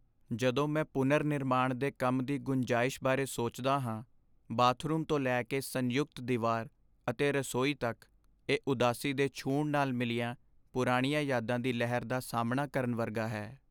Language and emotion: Punjabi, sad